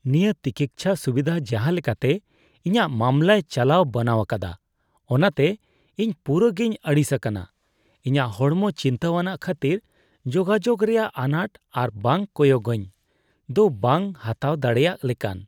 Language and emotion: Santali, disgusted